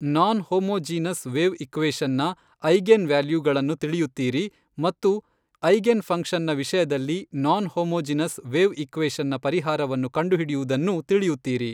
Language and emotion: Kannada, neutral